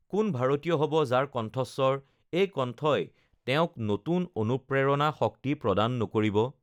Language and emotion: Assamese, neutral